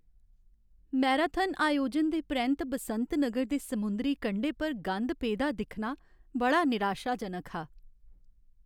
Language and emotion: Dogri, sad